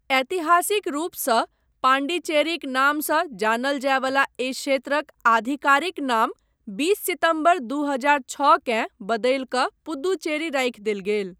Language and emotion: Maithili, neutral